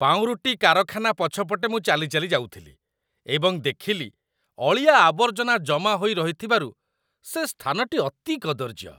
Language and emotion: Odia, disgusted